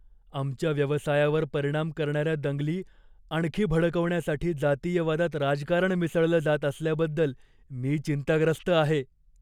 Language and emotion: Marathi, fearful